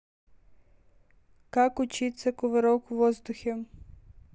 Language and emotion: Russian, neutral